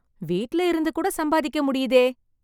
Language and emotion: Tamil, happy